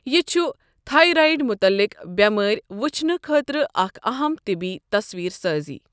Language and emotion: Kashmiri, neutral